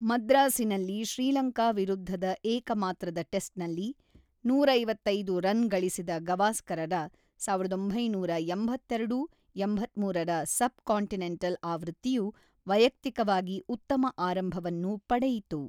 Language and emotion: Kannada, neutral